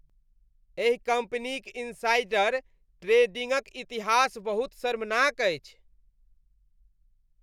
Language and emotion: Maithili, disgusted